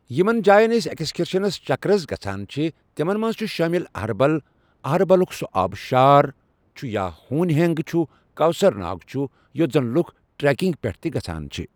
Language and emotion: Kashmiri, neutral